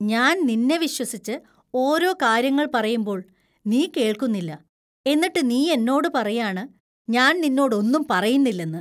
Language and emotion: Malayalam, disgusted